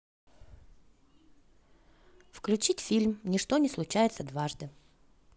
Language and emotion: Russian, positive